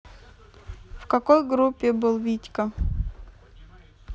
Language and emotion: Russian, neutral